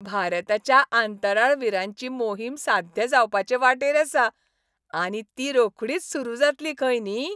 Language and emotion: Goan Konkani, happy